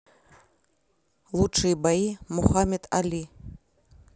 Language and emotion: Russian, neutral